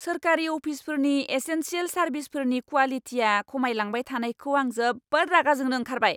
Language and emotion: Bodo, angry